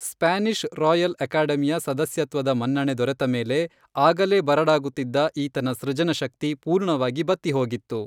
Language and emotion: Kannada, neutral